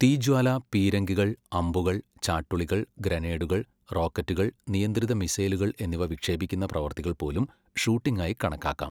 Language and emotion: Malayalam, neutral